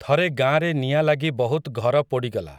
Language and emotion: Odia, neutral